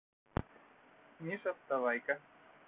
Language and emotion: Russian, neutral